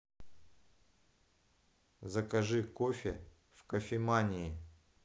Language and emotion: Russian, neutral